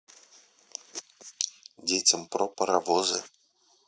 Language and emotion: Russian, neutral